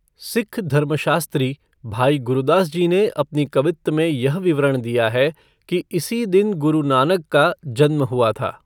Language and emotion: Hindi, neutral